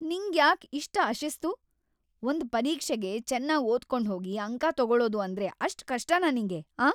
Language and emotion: Kannada, angry